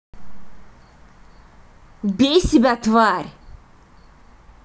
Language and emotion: Russian, angry